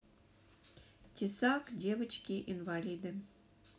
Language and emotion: Russian, neutral